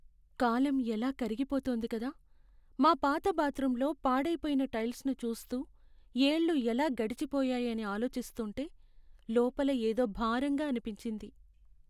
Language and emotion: Telugu, sad